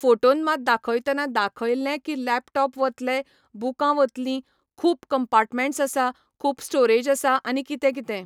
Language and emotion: Goan Konkani, neutral